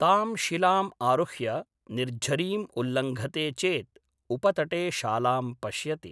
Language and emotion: Sanskrit, neutral